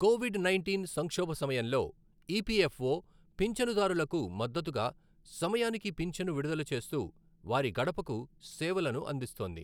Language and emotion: Telugu, neutral